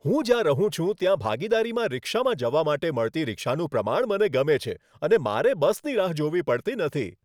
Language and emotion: Gujarati, happy